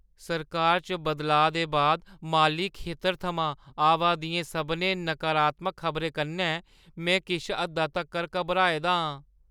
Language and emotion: Dogri, fearful